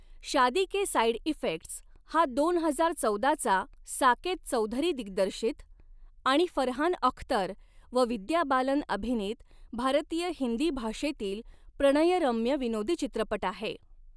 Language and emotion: Marathi, neutral